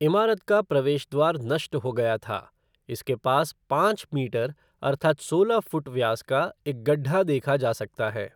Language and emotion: Hindi, neutral